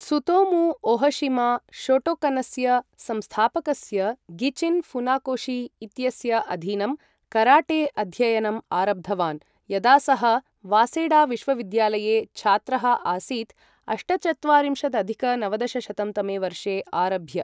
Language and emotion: Sanskrit, neutral